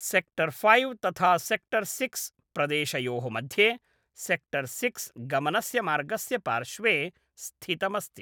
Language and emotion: Sanskrit, neutral